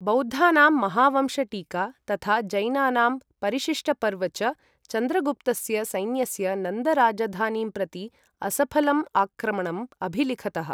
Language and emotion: Sanskrit, neutral